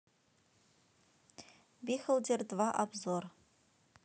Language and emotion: Russian, neutral